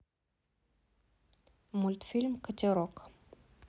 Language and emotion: Russian, neutral